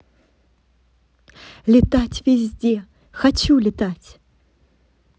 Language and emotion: Russian, positive